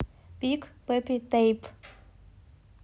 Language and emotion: Russian, neutral